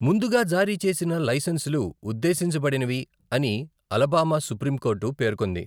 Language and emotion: Telugu, neutral